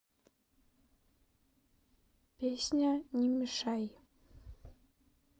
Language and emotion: Russian, neutral